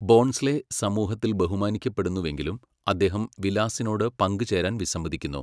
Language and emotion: Malayalam, neutral